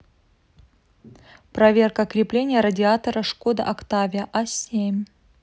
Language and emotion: Russian, neutral